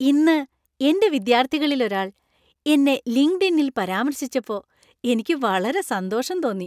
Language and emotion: Malayalam, happy